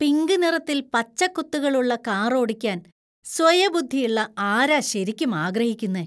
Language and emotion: Malayalam, disgusted